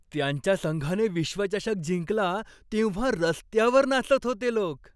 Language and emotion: Marathi, happy